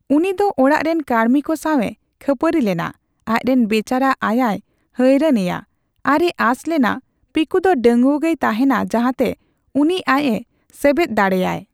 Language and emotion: Santali, neutral